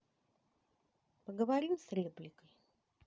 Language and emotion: Russian, neutral